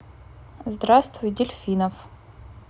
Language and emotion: Russian, neutral